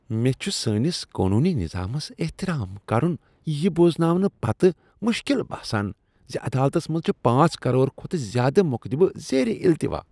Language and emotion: Kashmiri, disgusted